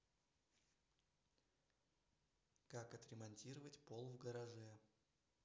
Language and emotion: Russian, neutral